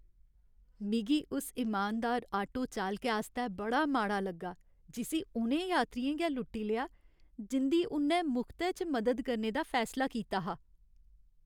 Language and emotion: Dogri, sad